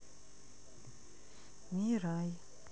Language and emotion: Russian, sad